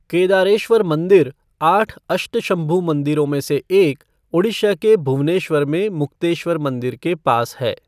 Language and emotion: Hindi, neutral